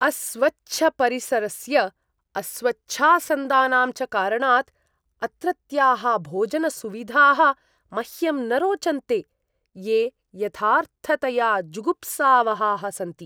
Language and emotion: Sanskrit, disgusted